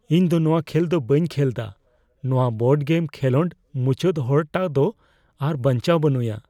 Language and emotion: Santali, fearful